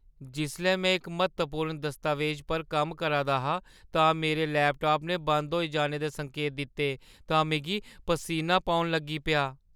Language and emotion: Dogri, fearful